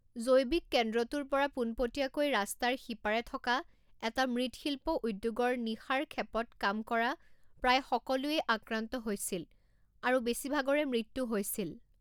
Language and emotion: Assamese, neutral